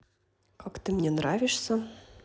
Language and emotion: Russian, neutral